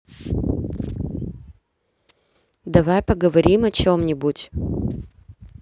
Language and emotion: Russian, neutral